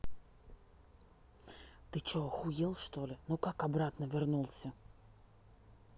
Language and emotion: Russian, angry